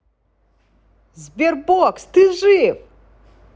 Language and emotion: Russian, positive